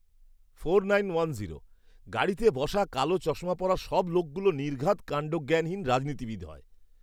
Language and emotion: Bengali, disgusted